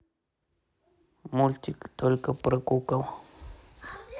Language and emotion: Russian, neutral